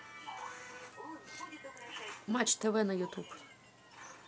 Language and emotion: Russian, neutral